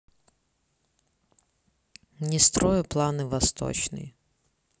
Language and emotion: Russian, neutral